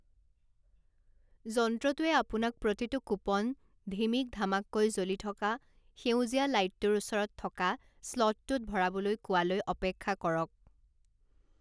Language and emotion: Assamese, neutral